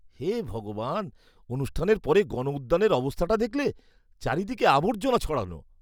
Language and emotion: Bengali, disgusted